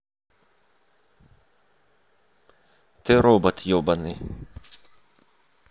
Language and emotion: Russian, neutral